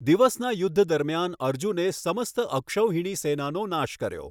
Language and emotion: Gujarati, neutral